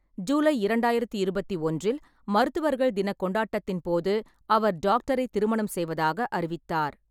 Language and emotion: Tamil, neutral